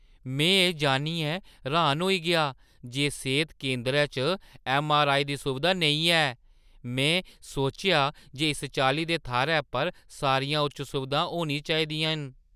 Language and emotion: Dogri, surprised